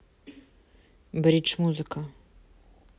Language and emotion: Russian, neutral